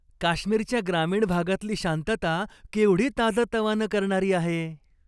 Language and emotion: Marathi, happy